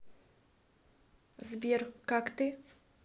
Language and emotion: Russian, neutral